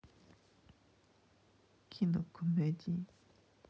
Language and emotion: Russian, neutral